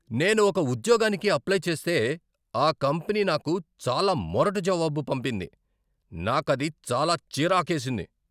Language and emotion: Telugu, angry